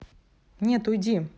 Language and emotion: Russian, angry